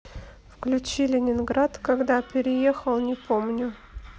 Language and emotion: Russian, neutral